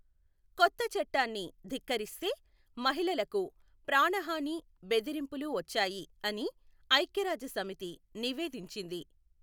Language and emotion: Telugu, neutral